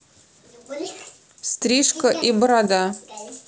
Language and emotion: Russian, neutral